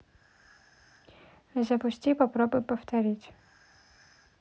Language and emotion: Russian, neutral